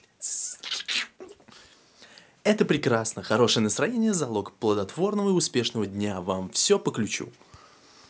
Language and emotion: Russian, positive